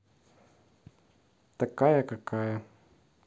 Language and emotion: Russian, neutral